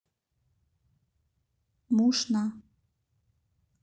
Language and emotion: Russian, neutral